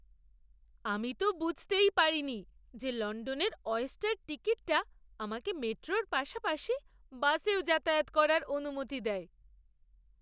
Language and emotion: Bengali, surprised